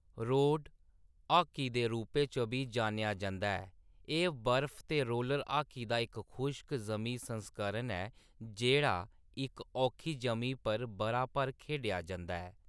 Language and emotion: Dogri, neutral